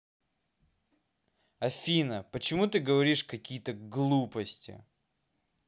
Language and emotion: Russian, angry